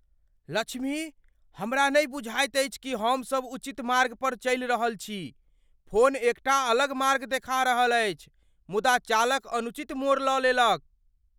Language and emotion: Maithili, fearful